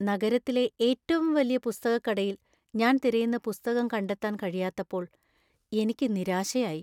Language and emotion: Malayalam, sad